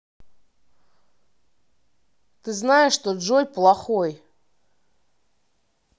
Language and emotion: Russian, angry